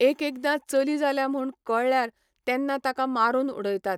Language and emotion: Goan Konkani, neutral